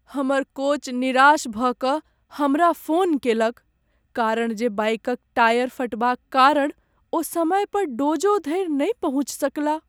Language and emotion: Maithili, sad